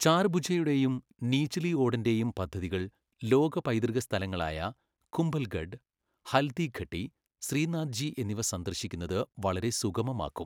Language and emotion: Malayalam, neutral